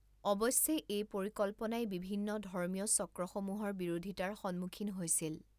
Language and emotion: Assamese, neutral